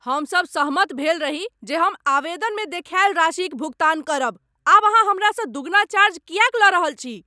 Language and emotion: Maithili, angry